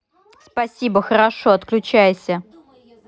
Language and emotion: Russian, neutral